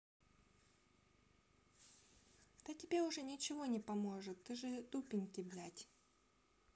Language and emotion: Russian, sad